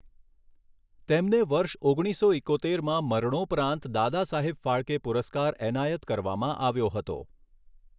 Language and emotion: Gujarati, neutral